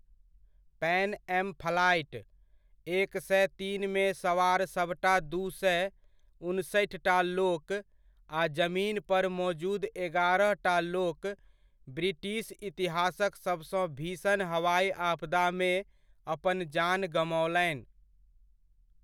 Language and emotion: Maithili, neutral